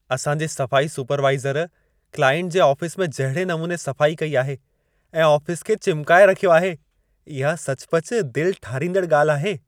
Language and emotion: Sindhi, happy